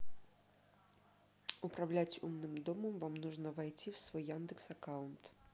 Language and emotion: Russian, neutral